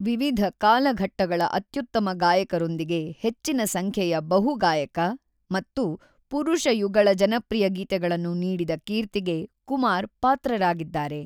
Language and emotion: Kannada, neutral